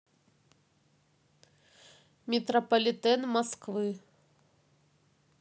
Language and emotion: Russian, neutral